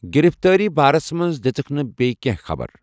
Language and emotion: Kashmiri, neutral